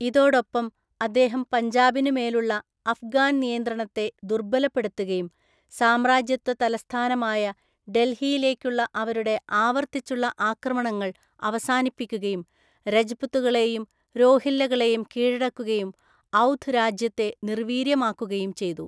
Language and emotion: Malayalam, neutral